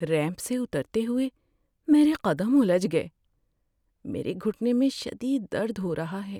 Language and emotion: Urdu, sad